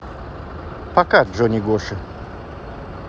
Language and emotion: Russian, neutral